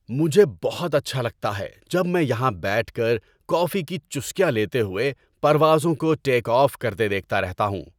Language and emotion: Urdu, happy